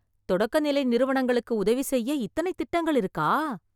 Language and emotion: Tamil, surprised